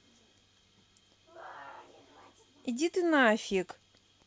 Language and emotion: Russian, neutral